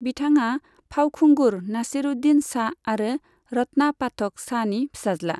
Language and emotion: Bodo, neutral